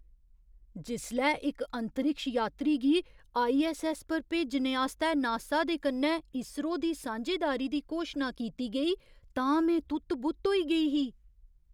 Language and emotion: Dogri, surprised